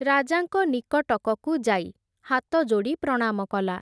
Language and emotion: Odia, neutral